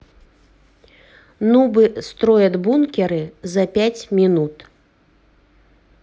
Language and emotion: Russian, neutral